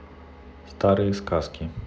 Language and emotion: Russian, neutral